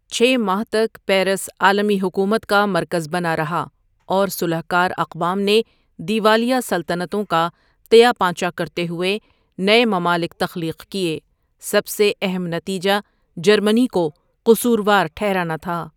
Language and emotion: Urdu, neutral